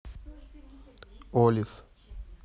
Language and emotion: Russian, neutral